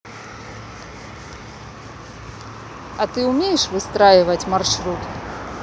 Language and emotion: Russian, neutral